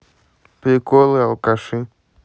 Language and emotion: Russian, neutral